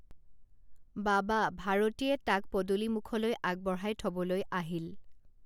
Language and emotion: Assamese, neutral